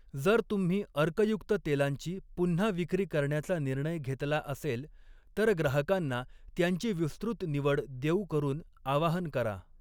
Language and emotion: Marathi, neutral